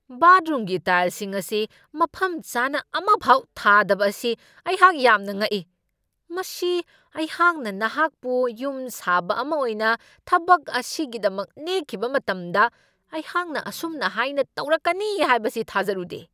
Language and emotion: Manipuri, angry